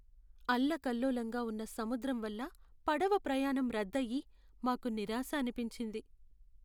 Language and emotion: Telugu, sad